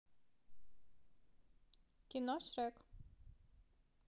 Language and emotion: Russian, neutral